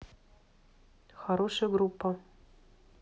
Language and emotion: Russian, neutral